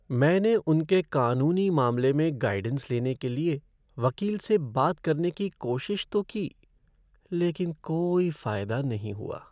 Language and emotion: Hindi, sad